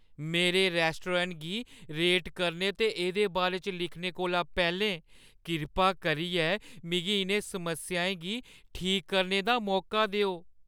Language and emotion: Dogri, fearful